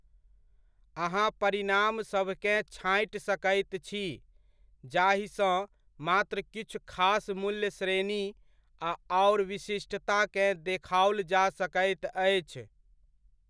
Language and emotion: Maithili, neutral